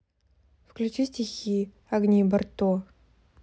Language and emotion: Russian, neutral